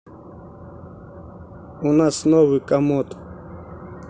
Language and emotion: Russian, neutral